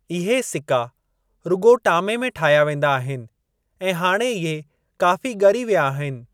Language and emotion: Sindhi, neutral